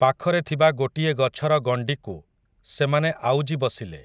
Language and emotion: Odia, neutral